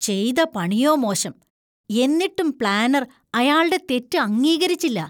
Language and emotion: Malayalam, disgusted